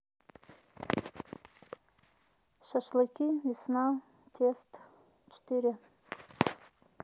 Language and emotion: Russian, neutral